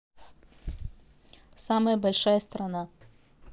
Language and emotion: Russian, neutral